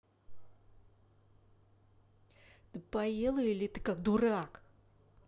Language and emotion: Russian, angry